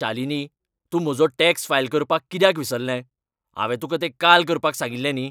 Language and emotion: Goan Konkani, angry